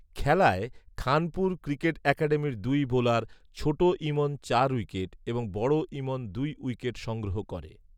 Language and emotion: Bengali, neutral